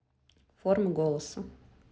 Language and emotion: Russian, neutral